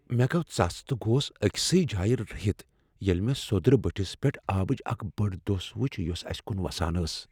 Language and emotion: Kashmiri, fearful